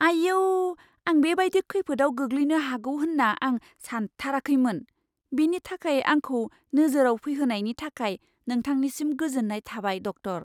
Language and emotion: Bodo, surprised